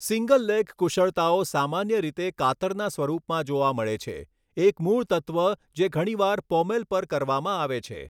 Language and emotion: Gujarati, neutral